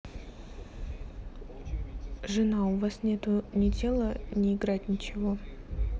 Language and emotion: Russian, neutral